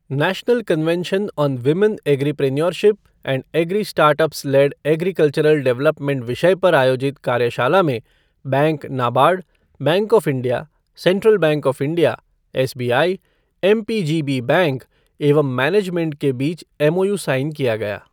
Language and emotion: Hindi, neutral